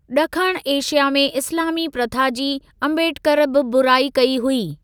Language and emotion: Sindhi, neutral